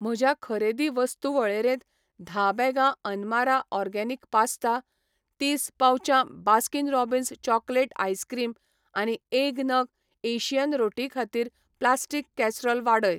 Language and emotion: Goan Konkani, neutral